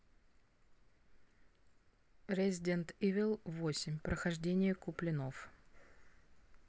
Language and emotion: Russian, neutral